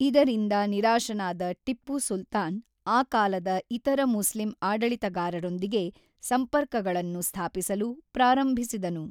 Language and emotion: Kannada, neutral